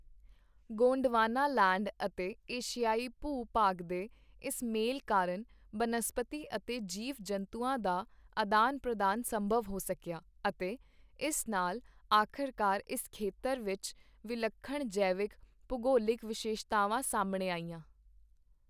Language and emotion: Punjabi, neutral